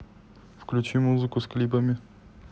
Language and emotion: Russian, neutral